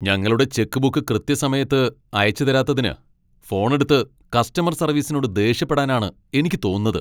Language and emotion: Malayalam, angry